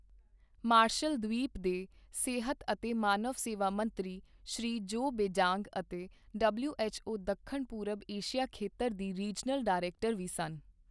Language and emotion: Punjabi, neutral